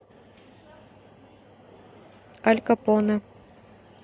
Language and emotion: Russian, neutral